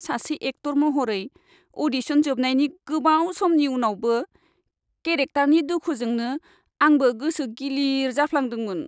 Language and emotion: Bodo, sad